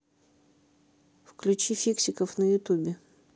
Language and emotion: Russian, neutral